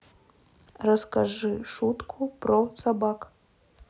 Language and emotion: Russian, neutral